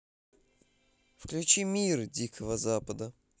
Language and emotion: Russian, neutral